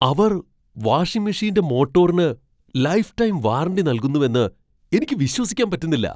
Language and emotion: Malayalam, surprised